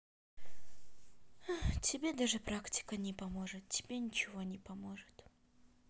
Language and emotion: Russian, sad